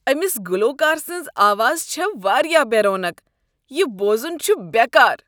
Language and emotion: Kashmiri, disgusted